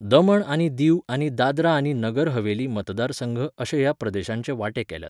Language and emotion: Goan Konkani, neutral